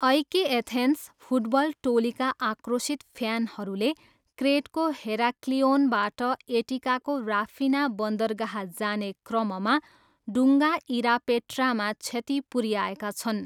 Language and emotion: Nepali, neutral